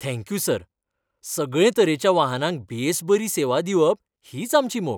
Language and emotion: Goan Konkani, happy